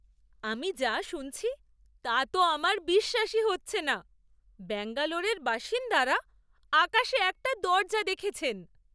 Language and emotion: Bengali, surprised